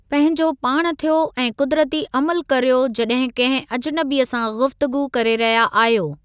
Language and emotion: Sindhi, neutral